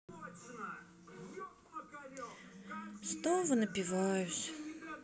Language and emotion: Russian, sad